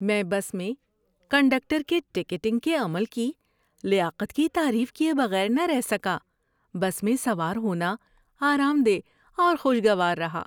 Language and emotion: Urdu, happy